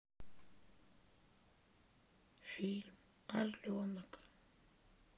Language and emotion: Russian, sad